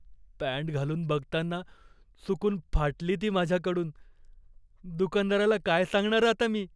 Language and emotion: Marathi, fearful